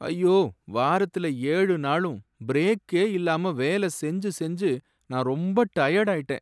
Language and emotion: Tamil, sad